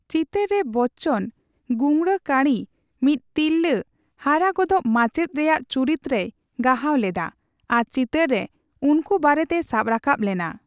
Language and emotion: Santali, neutral